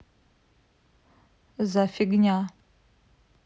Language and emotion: Russian, neutral